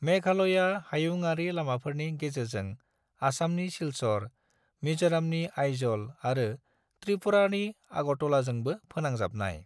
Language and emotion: Bodo, neutral